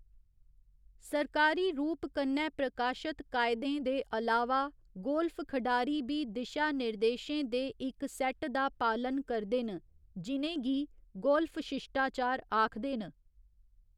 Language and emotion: Dogri, neutral